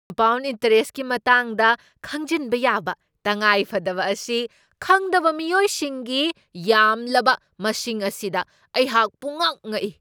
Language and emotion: Manipuri, surprised